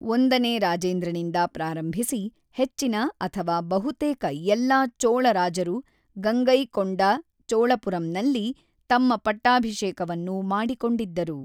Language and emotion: Kannada, neutral